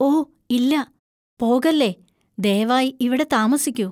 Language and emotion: Malayalam, fearful